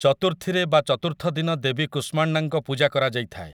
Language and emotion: Odia, neutral